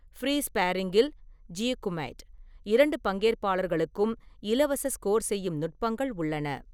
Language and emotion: Tamil, neutral